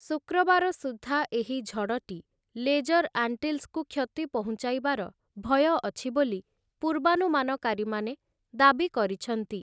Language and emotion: Odia, neutral